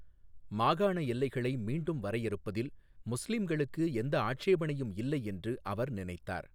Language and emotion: Tamil, neutral